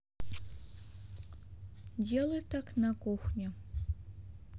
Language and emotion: Russian, neutral